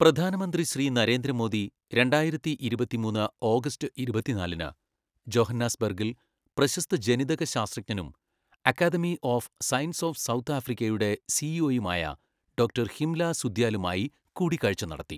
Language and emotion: Malayalam, neutral